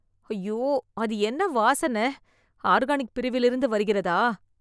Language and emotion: Tamil, disgusted